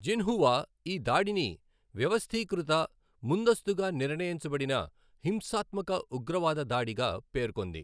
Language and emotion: Telugu, neutral